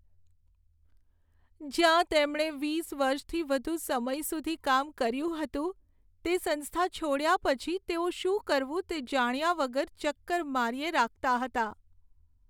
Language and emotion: Gujarati, sad